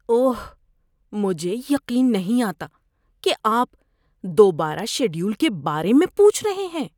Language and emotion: Urdu, disgusted